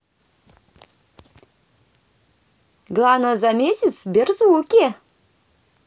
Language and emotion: Russian, positive